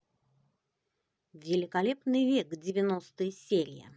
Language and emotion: Russian, positive